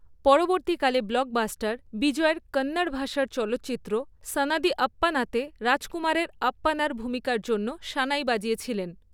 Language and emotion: Bengali, neutral